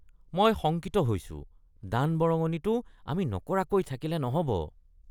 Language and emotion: Assamese, disgusted